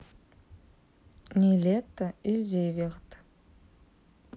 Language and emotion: Russian, neutral